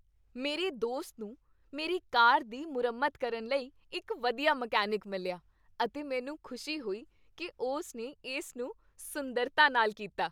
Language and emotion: Punjabi, happy